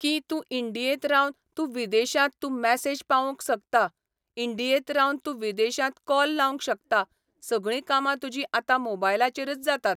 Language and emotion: Goan Konkani, neutral